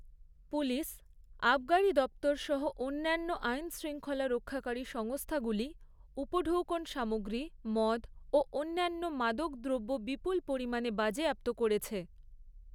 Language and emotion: Bengali, neutral